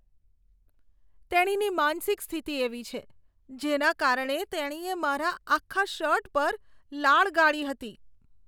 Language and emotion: Gujarati, disgusted